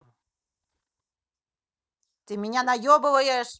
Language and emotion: Russian, angry